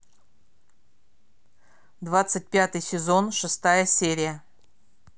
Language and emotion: Russian, neutral